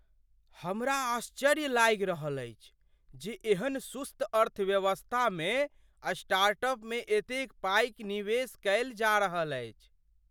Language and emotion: Maithili, surprised